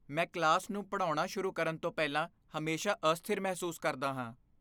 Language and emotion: Punjabi, fearful